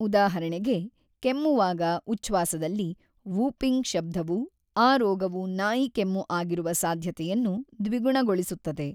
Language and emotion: Kannada, neutral